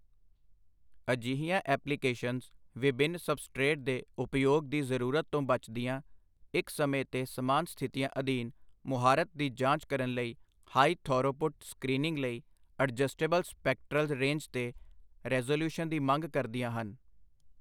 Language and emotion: Punjabi, neutral